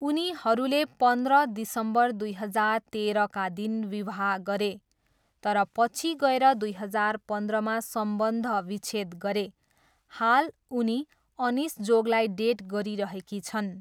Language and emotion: Nepali, neutral